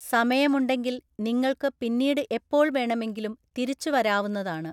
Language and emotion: Malayalam, neutral